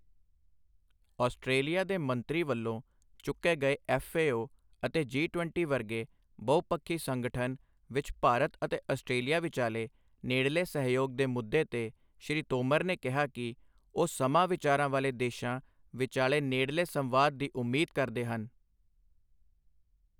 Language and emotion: Punjabi, neutral